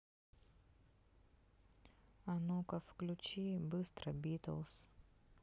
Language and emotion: Russian, neutral